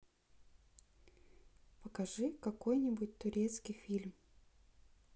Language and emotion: Russian, neutral